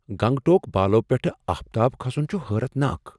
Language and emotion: Kashmiri, surprised